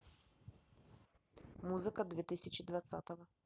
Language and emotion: Russian, neutral